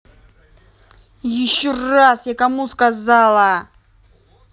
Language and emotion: Russian, angry